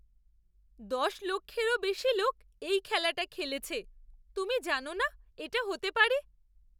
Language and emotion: Bengali, surprised